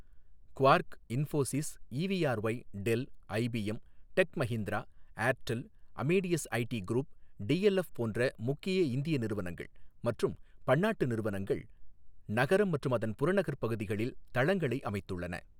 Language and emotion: Tamil, neutral